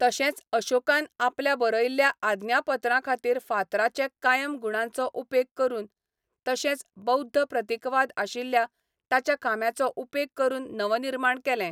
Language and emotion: Goan Konkani, neutral